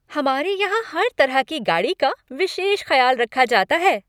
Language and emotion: Hindi, happy